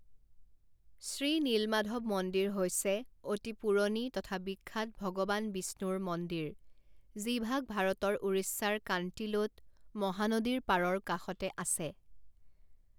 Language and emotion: Assamese, neutral